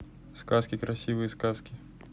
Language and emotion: Russian, neutral